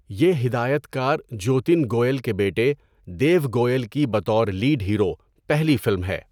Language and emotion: Urdu, neutral